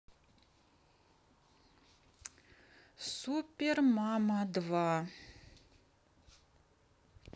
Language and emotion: Russian, neutral